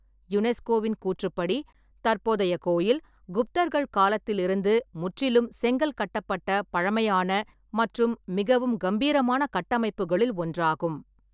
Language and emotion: Tamil, neutral